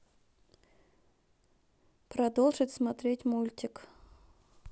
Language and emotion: Russian, neutral